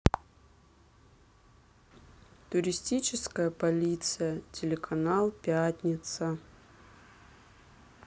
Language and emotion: Russian, sad